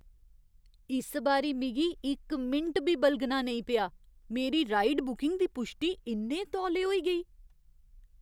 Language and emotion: Dogri, surprised